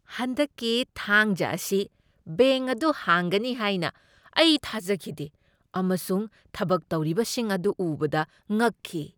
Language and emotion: Manipuri, surprised